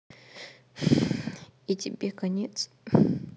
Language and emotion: Russian, sad